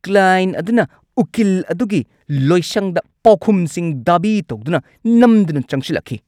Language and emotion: Manipuri, angry